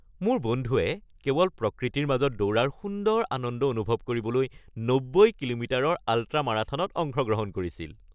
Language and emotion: Assamese, happy